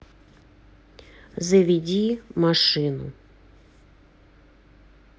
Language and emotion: Russian, neutral